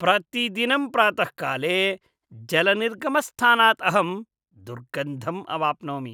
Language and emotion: Sanskrit, disgusted